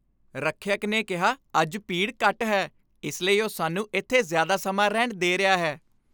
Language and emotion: Punjabi, happy